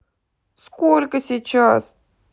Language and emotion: Russian, angry